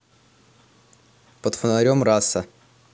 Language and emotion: Russian, neutral